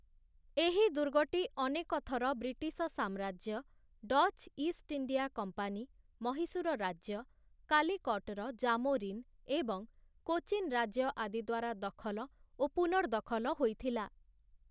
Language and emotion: Odia, neutral